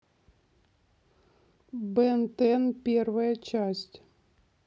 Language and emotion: Russian, neutral